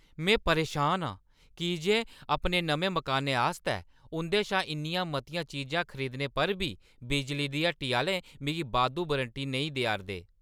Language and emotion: Dogri, angry